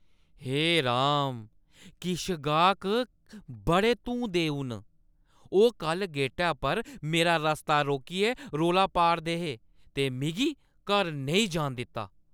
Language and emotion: Dogri, angry